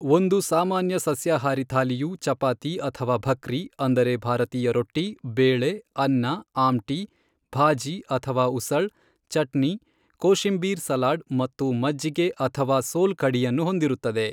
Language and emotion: Kannada, neutral